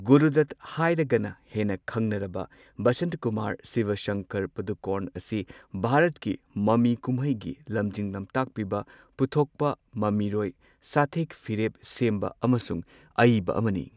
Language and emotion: Manipuri, neutral